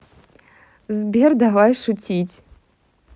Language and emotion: Russian, neutral